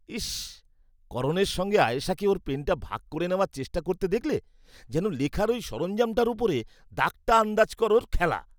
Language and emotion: Bengali, disgusted